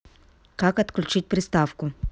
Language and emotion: Russian, neutral